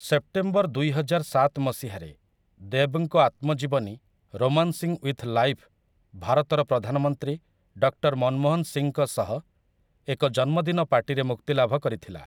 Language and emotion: Odia, neutral